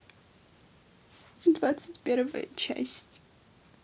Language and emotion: Russian, sad